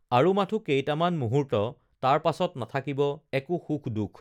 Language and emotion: Assamese, neutral